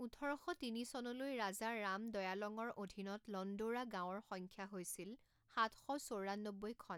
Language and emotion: Assamese, neutral